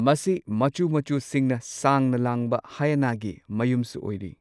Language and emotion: Manipuri, neutral